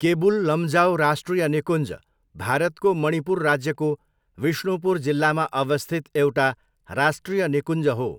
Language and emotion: Nepali, neutral